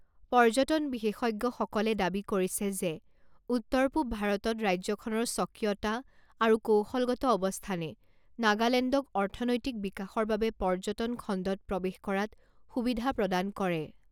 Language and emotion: Assamese, neutral